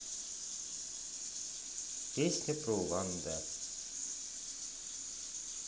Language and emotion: Russian, neutral